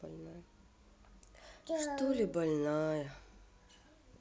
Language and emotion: Russian, sad